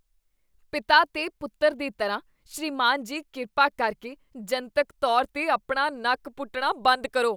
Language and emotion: Punjabi, disgusted